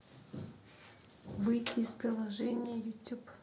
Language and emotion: Russian, neutral